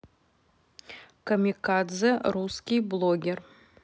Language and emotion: Russian, neutral